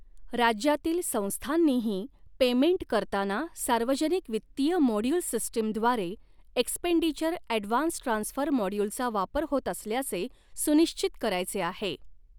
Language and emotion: Marathi, neutral